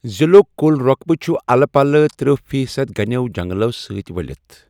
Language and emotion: Kashmiri, neutral